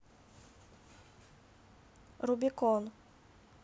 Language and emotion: Russian, neutral